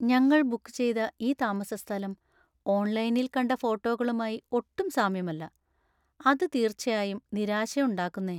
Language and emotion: Malayalam, sad